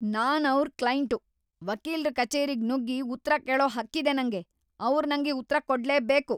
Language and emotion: Kannada, angry